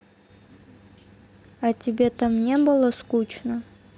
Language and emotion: Russian, neutral